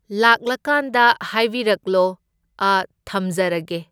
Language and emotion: Manipuri, neutral